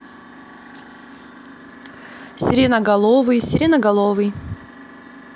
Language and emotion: Russian, neutral